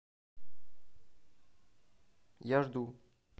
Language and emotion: Russian, neutral